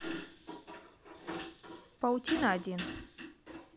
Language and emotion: Russian, neutral